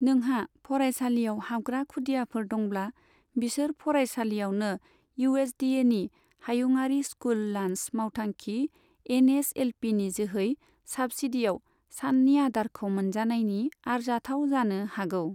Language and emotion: Bodo, neutral